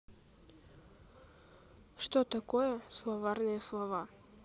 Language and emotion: Russian, neutral